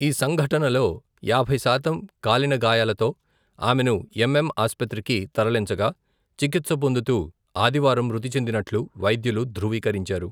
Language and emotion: Telugu, neutral